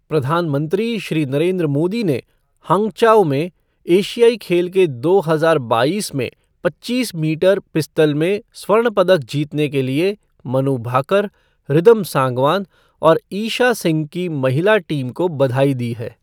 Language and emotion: Hindi, neutral